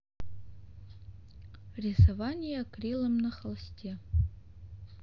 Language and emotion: Russian, neutral